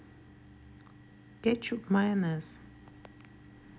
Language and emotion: Russian, neutral